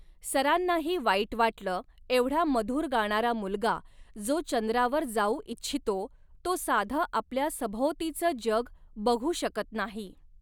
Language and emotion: Marathi, neutral